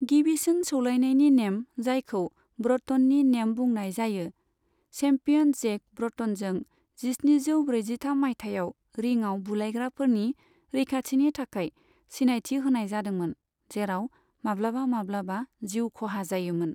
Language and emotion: Bodo, neutral